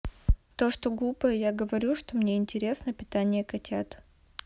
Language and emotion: Russian, neutral